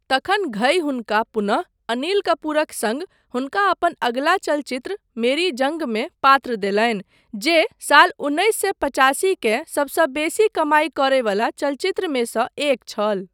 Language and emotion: Maithili, neutral